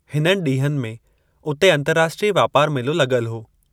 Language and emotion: Sindhi, neutral